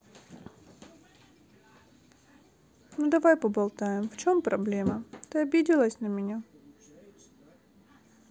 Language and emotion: Russian, sad